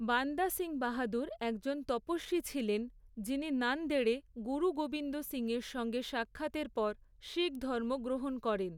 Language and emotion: Bengali, neutral